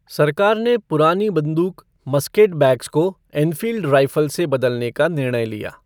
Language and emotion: Hindi, neutral